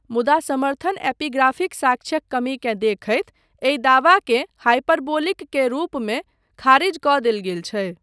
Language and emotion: Maithili, neutral